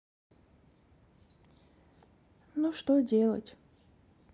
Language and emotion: Russian, sad